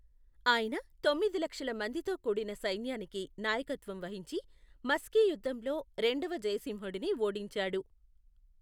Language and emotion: Telugu, neutral